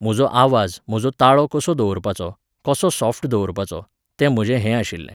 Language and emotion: Goan Konkani, neutral